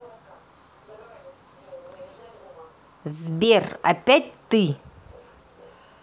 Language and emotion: Russian, angry